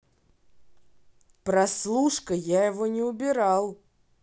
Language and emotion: Russian, neutral